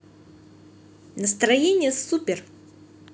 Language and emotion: Russian, positive